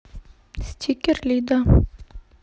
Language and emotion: Russian, neutral